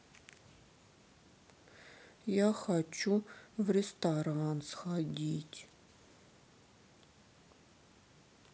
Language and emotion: Russian, sad